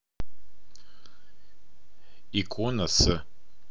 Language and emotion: Russian, neutral